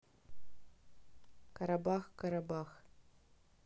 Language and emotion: Russian, neutral